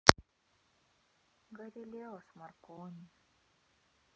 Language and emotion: Russian, sad